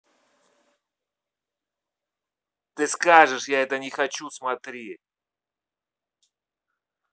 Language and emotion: Russian, angry